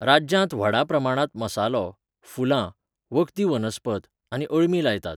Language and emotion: Goan Konkani, neutral